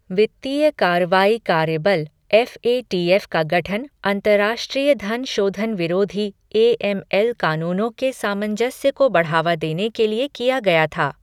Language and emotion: Hindi, neutral